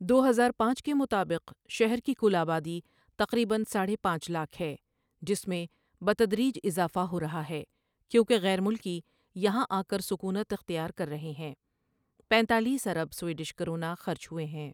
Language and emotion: Urdu, neutral